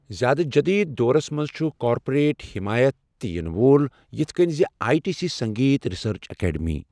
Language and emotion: Kashmiri, neutral